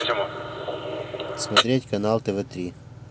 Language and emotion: Russian, neutral